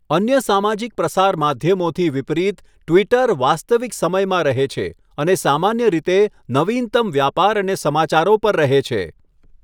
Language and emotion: Gujarati, neutral